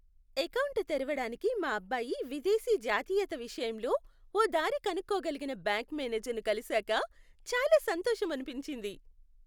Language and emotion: Telugu, happy